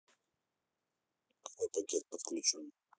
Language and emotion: Russian, neutral